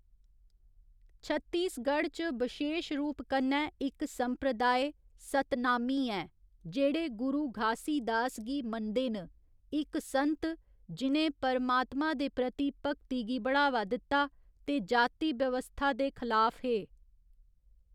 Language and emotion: Dogri, neutral